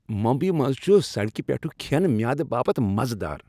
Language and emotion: Kashmiri, happy